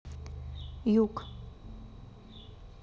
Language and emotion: Russian, neutral